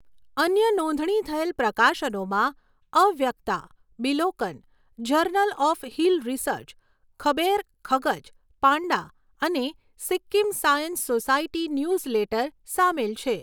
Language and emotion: Gujarati, neutral